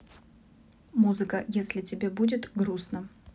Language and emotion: Russian, neutral